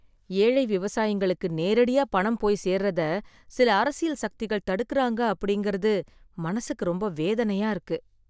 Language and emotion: Tamil, sad